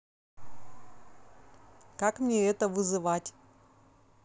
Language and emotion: Russian, neutral